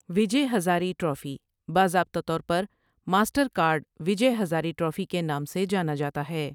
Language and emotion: Urdu, neutral